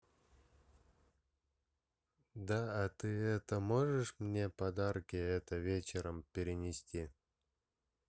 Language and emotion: Russian, neutral